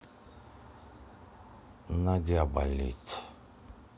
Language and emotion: Russian, sad